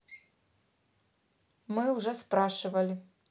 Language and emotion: Russian, neutral